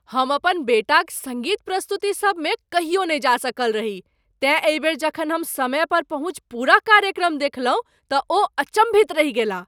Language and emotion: Maithili, surprised